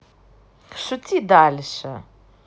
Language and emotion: Russian, positive